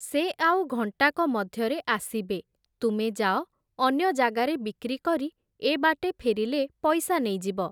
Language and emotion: Odia, neutral